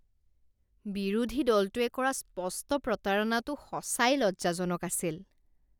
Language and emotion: Assamese, disgusted